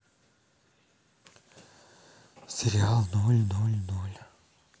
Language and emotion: Russian, sad